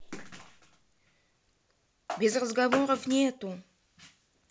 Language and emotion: Russian, neutral